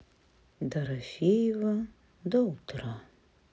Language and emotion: Russian, sad